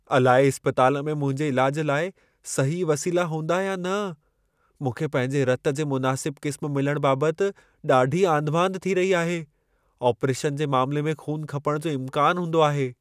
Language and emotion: Sindhi, fearful